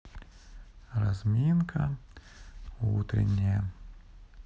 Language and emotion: Russian, neutral